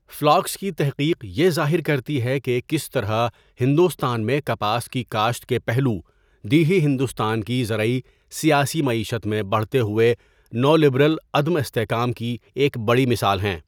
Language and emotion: Urdu, neutral